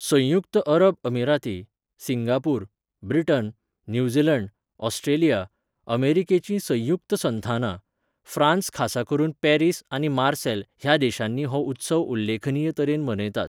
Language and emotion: Goan Konkani, neutral